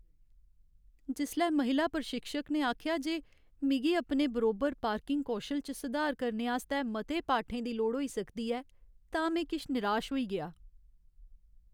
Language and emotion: Dogri, sad